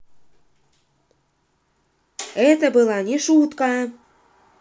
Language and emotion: Russian, angry